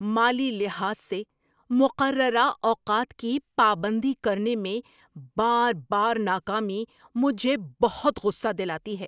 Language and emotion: Urdu, angry